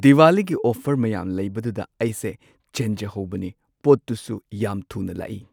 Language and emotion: Manipuri, neutral